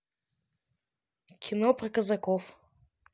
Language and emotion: Russian, neutral